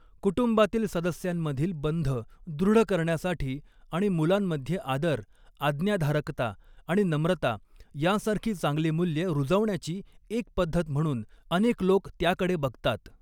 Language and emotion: Marathi, neutral